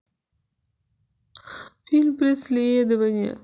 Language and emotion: Russian, sad